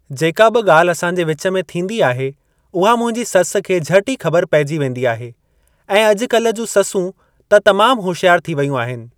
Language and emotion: Sindhi, neutral